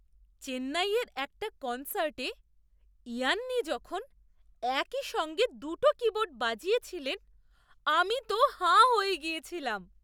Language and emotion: Bengali, surprised